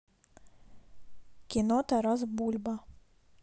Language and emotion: Russian, neutral